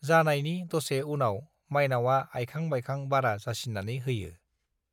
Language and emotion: Bodo, neutral